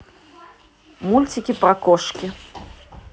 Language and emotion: Russian, neutral